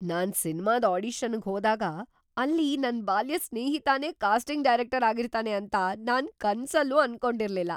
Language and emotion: Kannada, surprised